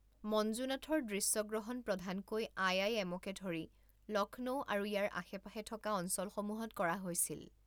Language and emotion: Assamese, neutral